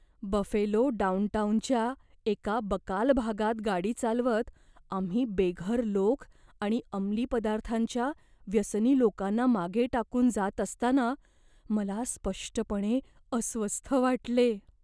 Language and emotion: Marathi, fearful